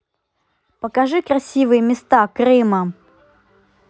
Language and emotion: Russian, neutral